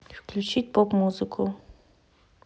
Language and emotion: Russian, neutral